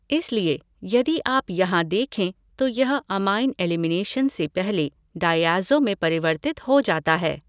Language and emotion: Hindi, neutral